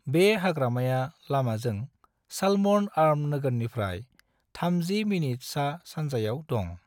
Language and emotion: Bodo, neutral